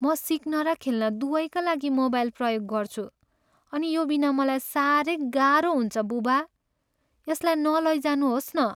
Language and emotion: Nepali, sad